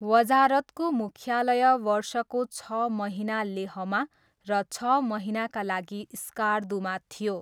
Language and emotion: Nepali, neutral